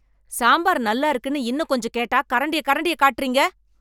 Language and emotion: Tamil, angry